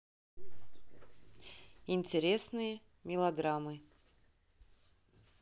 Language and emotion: Russian, neutral